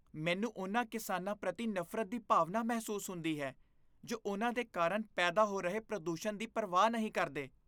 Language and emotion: Punjabi, disgusted